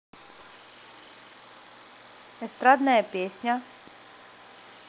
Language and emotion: Russian, neutral